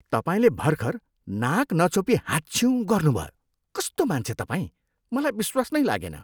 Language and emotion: Nepali, disgusted